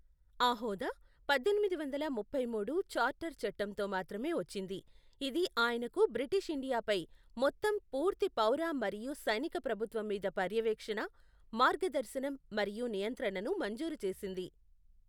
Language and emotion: Telugu, neutral